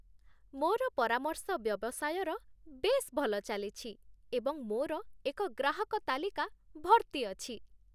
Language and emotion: Odia, happy